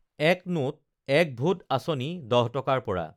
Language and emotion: Assamese, neutral